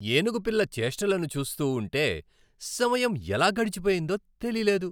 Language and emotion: Telugu, happy